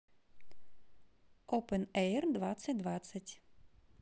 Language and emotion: Russian, neutral